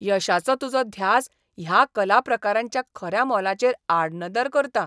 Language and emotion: Goan Konkani, disgusted